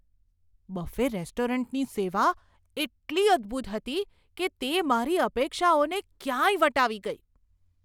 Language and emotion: Gujarati, surprised